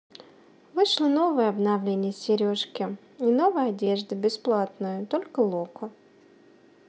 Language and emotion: Russian, neutral